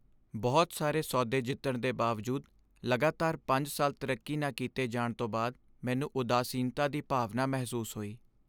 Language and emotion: Punjabi, sad